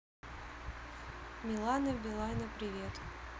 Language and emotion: Russian, neutral